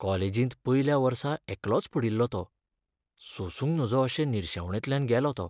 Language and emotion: Goan Konkani, sad